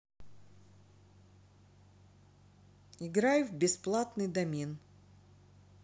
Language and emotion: Russian, neutral